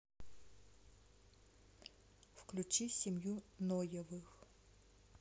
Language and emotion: Russian, neutral